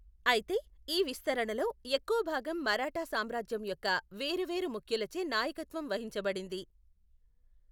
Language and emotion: Telugu, neutral